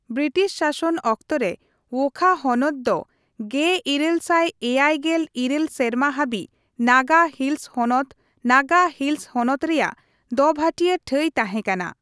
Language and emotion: Santali, neutral